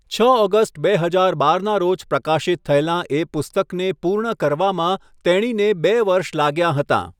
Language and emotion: Gujarati, neutral